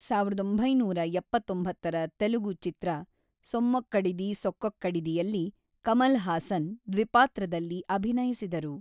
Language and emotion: Kannada, neutral